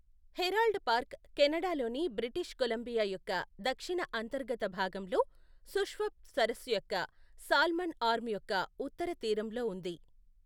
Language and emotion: Telugu, neutral